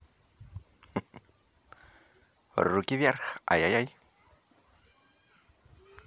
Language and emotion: Russian, positive